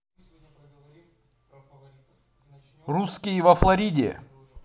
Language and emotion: Russian, positive